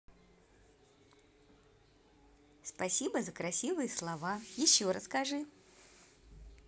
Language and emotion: Russian, positive